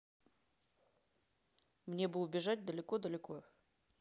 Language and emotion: Russian, neutral